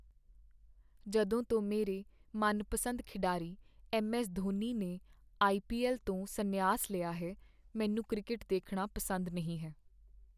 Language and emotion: Punjabi, sad